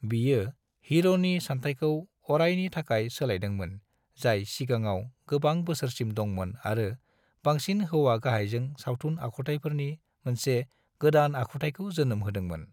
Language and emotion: Bodo, neutral